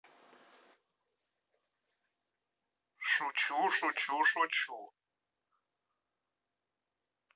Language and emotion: Russian, neutral